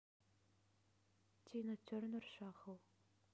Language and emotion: Russian, neutral